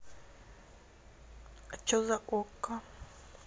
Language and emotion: Russian, neutral